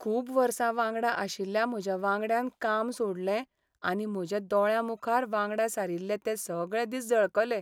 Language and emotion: Goan Konkani, sad